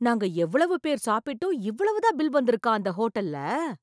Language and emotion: Tamil, surprised